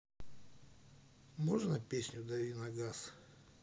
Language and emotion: Russian, neutral